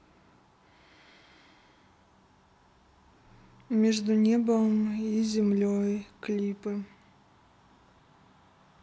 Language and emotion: Russian, sad